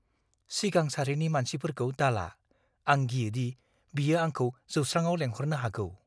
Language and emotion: Bodo, fearful